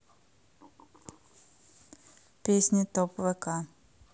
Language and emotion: Russian, neutral